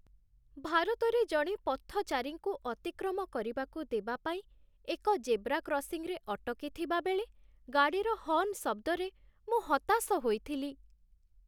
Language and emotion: Odia, sad